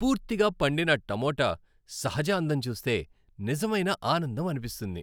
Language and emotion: Telugu, happy